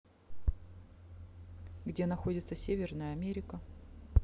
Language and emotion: Russian, neutral